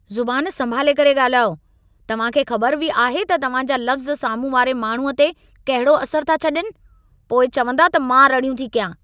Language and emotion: Sindhi, angry